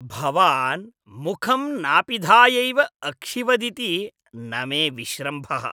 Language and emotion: Sanskrit, disgusted